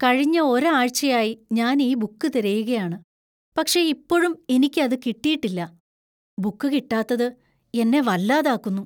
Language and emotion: Malayalam, fearful